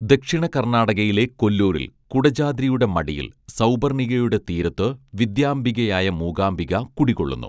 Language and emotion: Malayalam, neutral